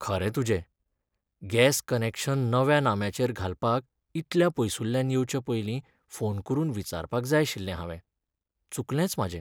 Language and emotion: Goan Konkani, sad